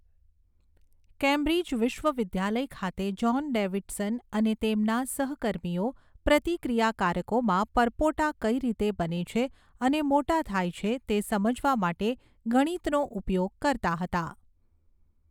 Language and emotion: Gujarati, neutral